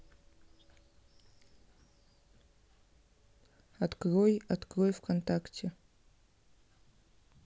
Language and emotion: Russian, neutral